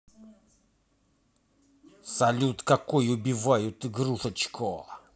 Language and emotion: Russian, angry